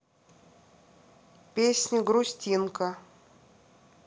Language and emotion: Russian, neutral